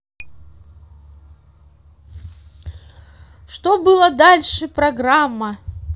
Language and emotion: Russian, positive